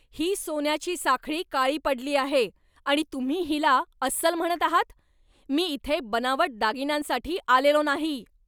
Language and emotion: Marathi, angry